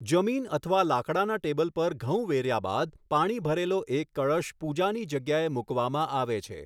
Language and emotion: Gujarati, neutral